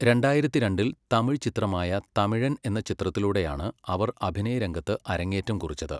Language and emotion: Malayalam, neutral